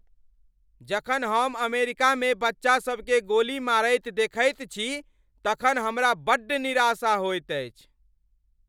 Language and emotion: Maithili, angry